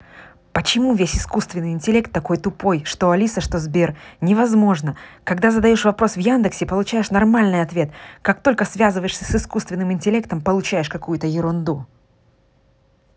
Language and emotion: Russian, angry